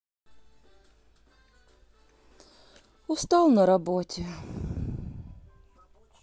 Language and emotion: Russian, sad